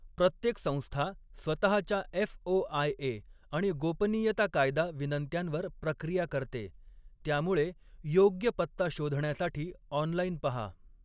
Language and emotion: Marathi, neutral